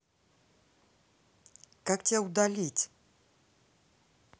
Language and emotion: Russian, angry